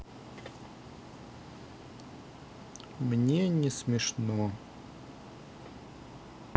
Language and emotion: Russian, sad